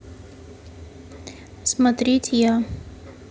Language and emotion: Russian, neutral